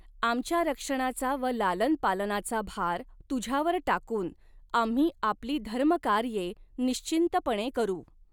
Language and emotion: Marathi, neutral